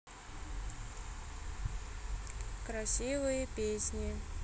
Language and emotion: Russian, neutral